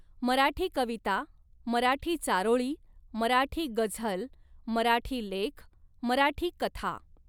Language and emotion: Marathi, neutral